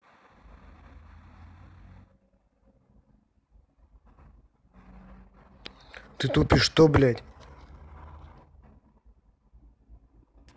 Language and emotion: Russian, angry